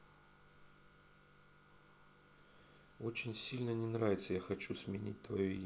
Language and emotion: Russian, neutral